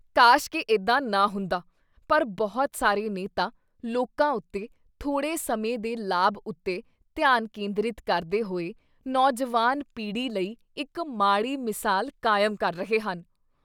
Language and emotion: Punjabi, disgusted